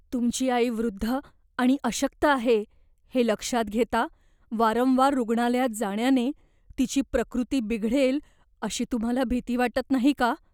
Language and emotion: Marathi, fearful